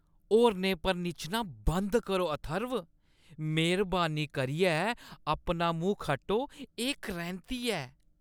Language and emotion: Dogri, disgusted